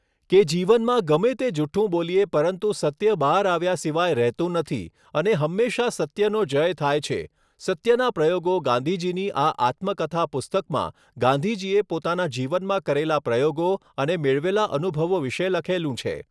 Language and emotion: Gujarati, neutral